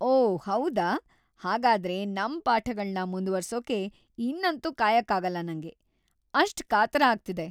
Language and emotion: Kannada, happy